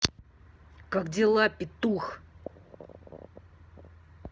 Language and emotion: Russian, angry